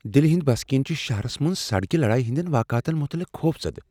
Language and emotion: Kashmiri, fearful